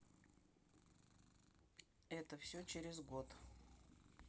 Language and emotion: Russian, neutral